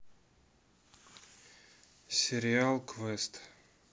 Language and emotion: Russian, neutral